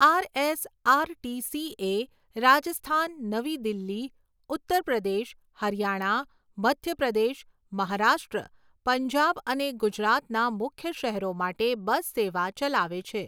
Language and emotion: Gujarati, neutral